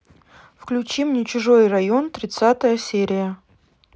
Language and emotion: Russian, neutral